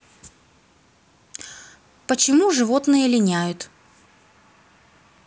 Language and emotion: Russian, neutral